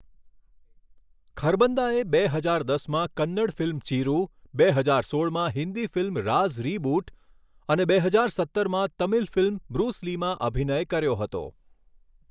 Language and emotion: Gujarati, neutral